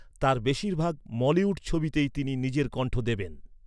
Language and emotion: Bengali, neutral